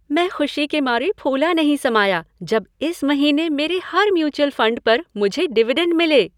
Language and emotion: Hindi, happy